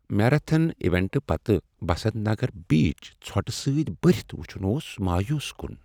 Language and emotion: Kashmiri, sad